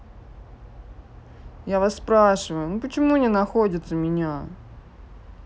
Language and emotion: Russian, sad